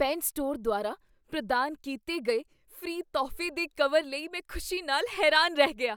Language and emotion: Punjabi, surprised